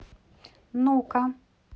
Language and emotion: Russian, neutral